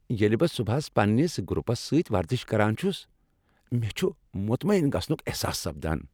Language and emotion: Kashmiri, happy